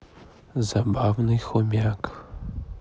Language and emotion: Russian, neutral